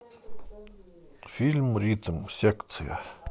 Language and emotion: Russian, neutral